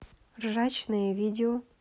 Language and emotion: Russian, neutral